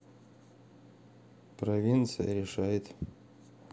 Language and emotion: Russian, neutral